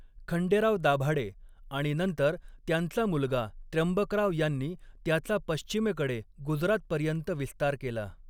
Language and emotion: Marathi, neutral